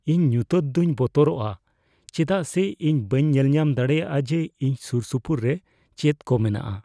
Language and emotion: Santali, fearful